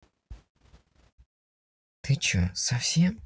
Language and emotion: Russian, angry